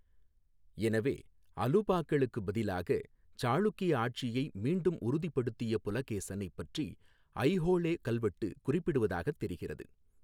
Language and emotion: Tamil, neutral